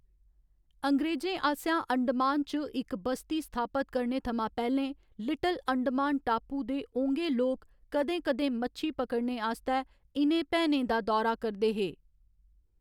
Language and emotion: Dogri, neutral